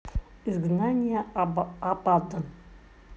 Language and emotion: Russian, neutral